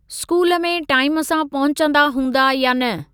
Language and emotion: Sindhi, neutral